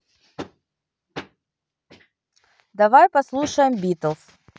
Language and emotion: Russian, neutral